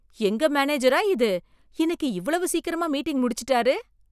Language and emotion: Tamil, surprised